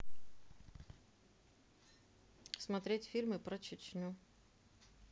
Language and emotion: Russian, neutral